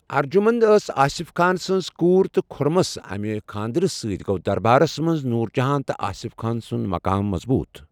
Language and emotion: Kashmiri, neutral